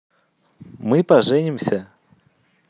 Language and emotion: Russian, positive